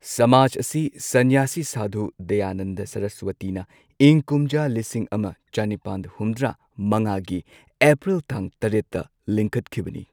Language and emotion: Manipuri, neutral